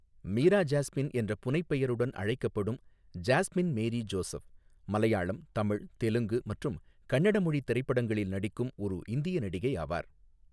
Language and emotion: Tamil, neutral